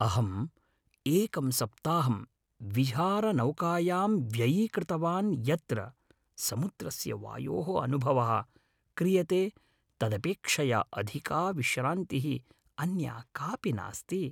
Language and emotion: Sanskrit, happy